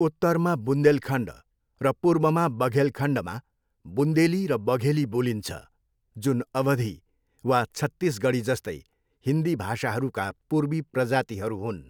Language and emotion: Nepali, neutral